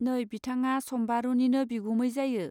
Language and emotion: Bodo, neutral